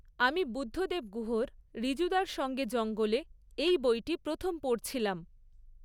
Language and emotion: Bengali, neutral